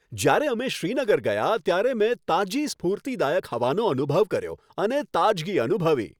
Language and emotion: Gujarati, happy